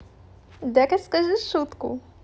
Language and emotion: Russian, positive